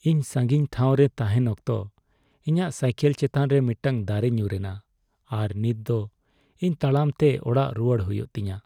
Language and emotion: Santali, sad